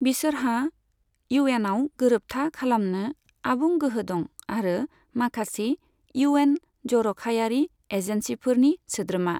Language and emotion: Bodo, neutral